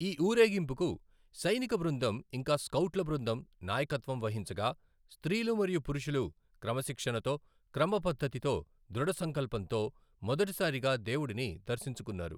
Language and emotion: Telugu, neutral